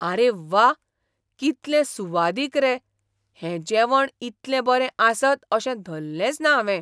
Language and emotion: Goan Konkani, surprised